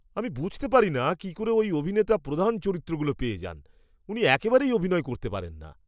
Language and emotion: Bengali, disgusted